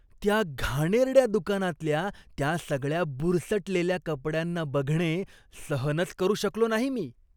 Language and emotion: Marathi, disgusted